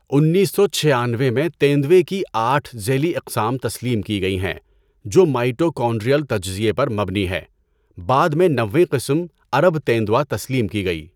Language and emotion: Urdu, neutral